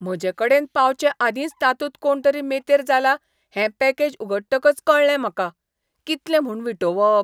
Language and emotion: Goan Konkani, disgusted